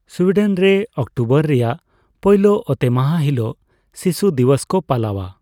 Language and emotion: Santali, neutral